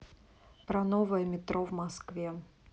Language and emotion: Russian, neutral